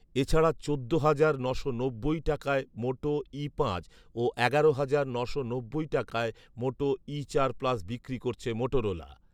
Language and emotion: Bengali, neutral